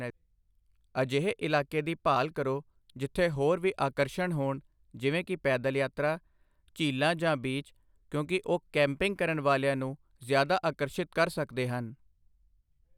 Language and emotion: Punjabi, neutral